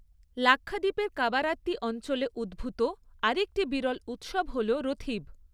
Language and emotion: Bengali, neutral